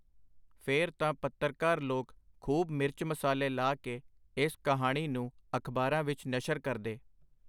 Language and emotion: Punjabi, neutral